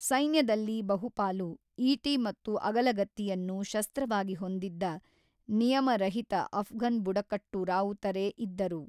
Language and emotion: Kannada, neutral